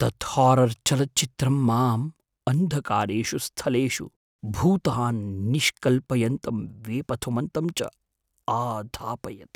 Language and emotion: Sanskrit, fearful